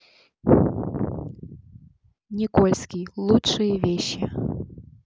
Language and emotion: Russian, neutral